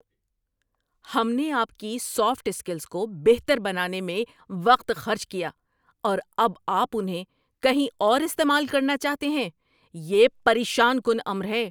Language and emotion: Urdu, angry